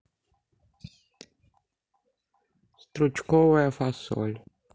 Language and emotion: Russian, neutral